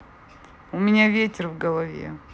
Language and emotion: Russian, neutral